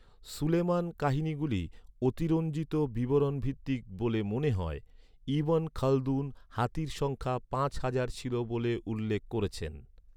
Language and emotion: Bengali, neutral